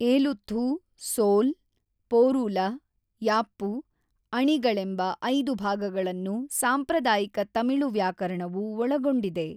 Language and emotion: Kannada, neutral